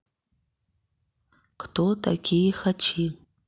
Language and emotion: Russian, neutral